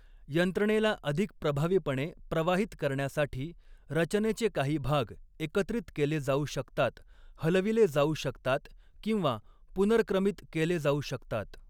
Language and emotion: Marathi, neutral